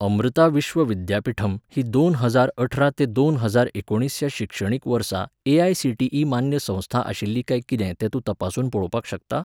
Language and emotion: Goan Konkani, neutral